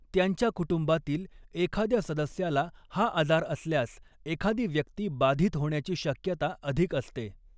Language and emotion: Marathi, neutral